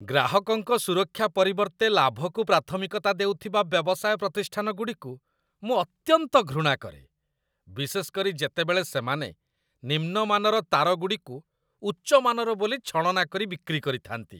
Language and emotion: Odia, disgusted